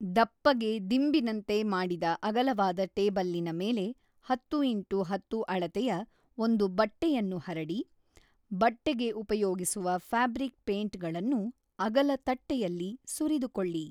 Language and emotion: Kannada, neutral